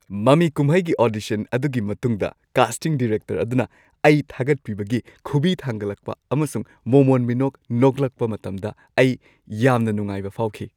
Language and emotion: Manipuri, happy